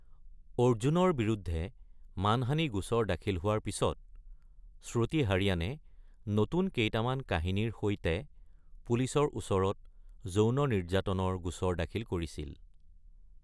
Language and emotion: Assamese, neutral